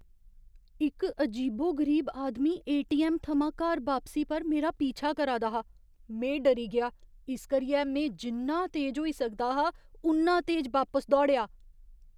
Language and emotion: Dogri, fearful